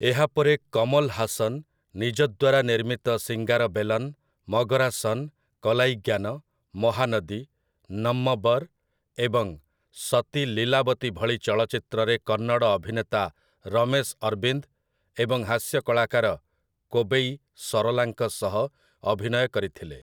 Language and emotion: Odia, neutral